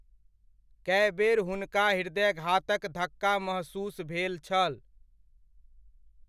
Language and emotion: Maithili, neutral